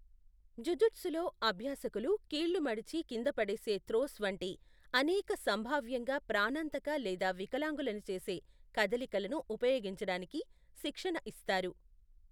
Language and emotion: Telugu, neutral